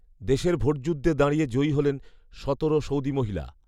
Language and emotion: Bengali, neutral